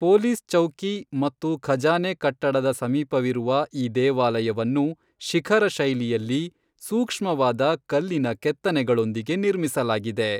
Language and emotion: Kannada, neutral